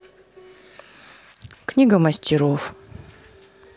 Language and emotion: Russian, neutral